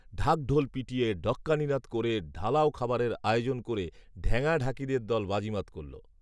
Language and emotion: Bengali, neutral